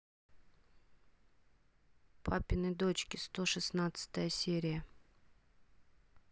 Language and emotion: Russian, neutral